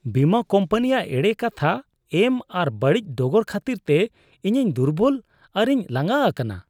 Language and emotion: Santali, disgusted